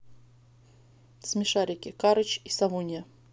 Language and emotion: Russian, neutral